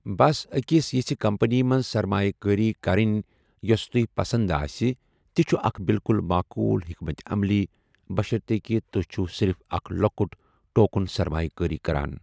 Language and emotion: Kashmiri, neutral